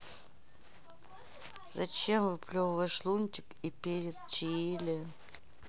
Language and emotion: Russian, sad